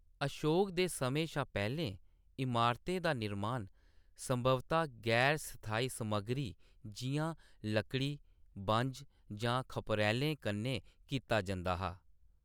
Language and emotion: Dogri, neutral